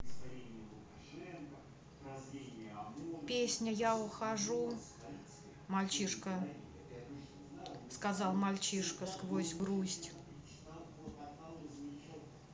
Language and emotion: Russian, neutral